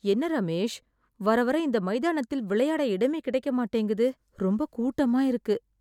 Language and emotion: Tamil, sad